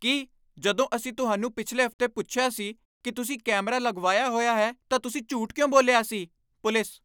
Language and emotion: Punjabi, angry